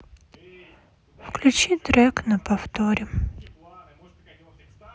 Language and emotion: Russian, sad